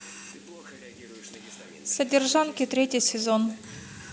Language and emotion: Russian, neutral